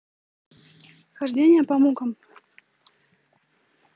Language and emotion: Russian, neutral